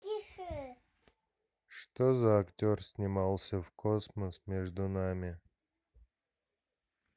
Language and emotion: Russian, sad